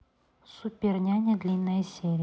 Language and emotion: Russian, neutral